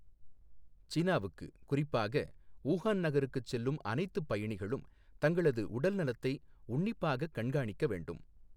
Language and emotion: Tamil, neutral